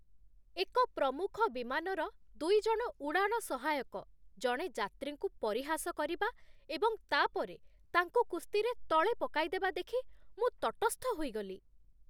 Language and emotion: Odia, disgusted